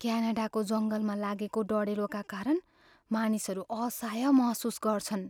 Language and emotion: Nepali, fearful